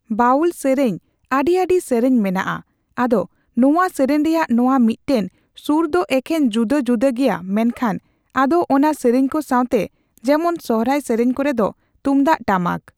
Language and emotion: Santali, neutral